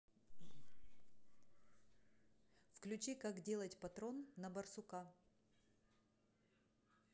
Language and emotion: Russian, neutral